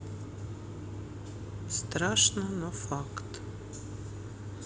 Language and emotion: Russian, neutral